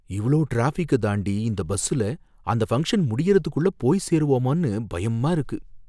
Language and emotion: Tamil, fearful